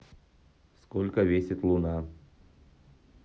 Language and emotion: Russian, neutral